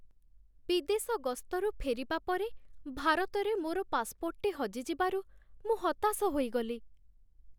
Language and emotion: Odia, sad